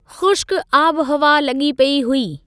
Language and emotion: Sindhi, neutral